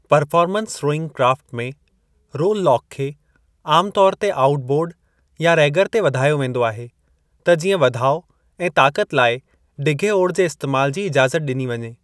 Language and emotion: Sindhi, neutral